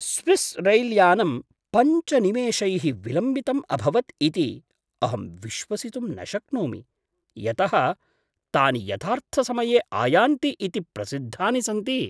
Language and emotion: Sanskrit, surprised